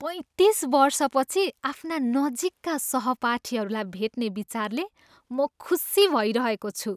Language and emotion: Nepali, happy